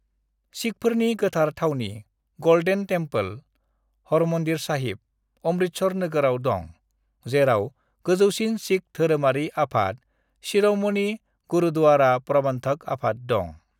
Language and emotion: Bodo, neutral